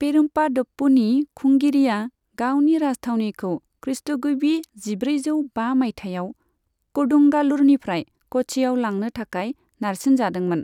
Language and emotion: Bodo, neutral